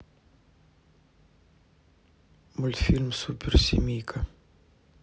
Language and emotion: Russian, neutral